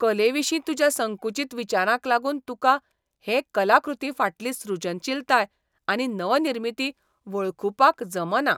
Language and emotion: Goan Konkani, disgusted